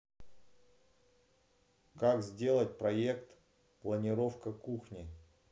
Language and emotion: Russian, neutral